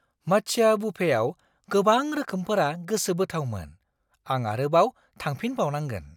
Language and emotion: Bodo, surprised